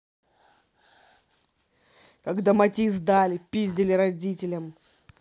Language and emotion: Russian, angry